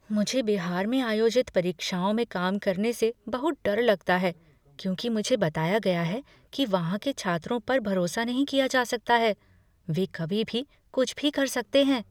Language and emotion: Hindi, fearful